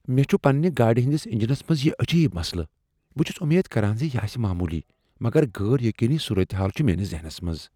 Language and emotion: Kashmiri, fearful